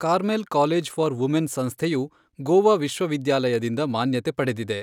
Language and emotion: Kannada, neutral